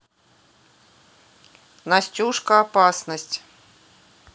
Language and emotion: Russian, neutral